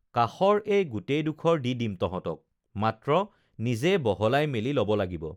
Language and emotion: Assamese, neutral